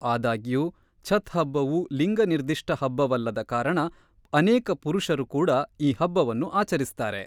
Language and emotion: Kannada, neutral